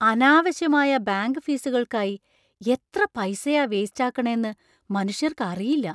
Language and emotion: Malayalam, surprised